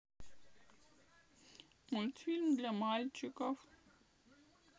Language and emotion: Russian, sad